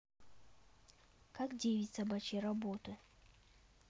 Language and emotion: Russian, neutral